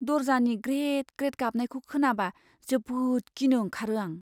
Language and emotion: Bodo, fearful